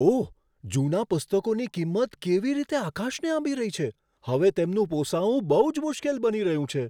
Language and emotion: Gujarati, surprised